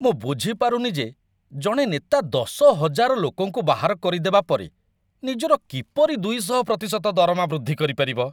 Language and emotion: Odia, disgusted